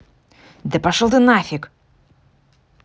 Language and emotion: Russian, angry